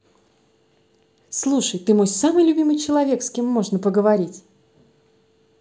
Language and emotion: Russian, positive